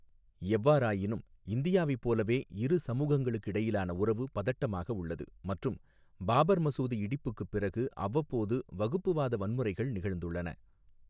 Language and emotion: Tamil, neutral